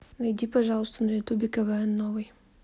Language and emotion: Russian, neutral